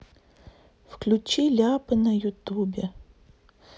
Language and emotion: Russian, sad